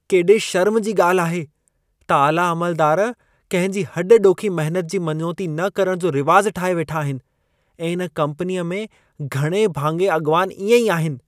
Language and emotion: Sindhi, disgusted